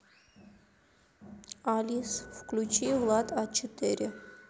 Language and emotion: Russian, neutral